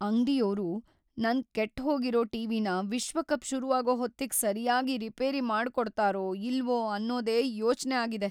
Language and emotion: Kannada, fearful